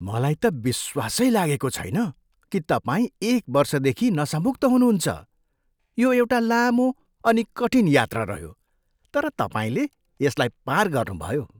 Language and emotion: Nepali, surprised